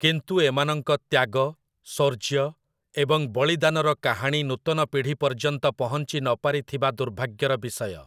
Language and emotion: Odia, neutral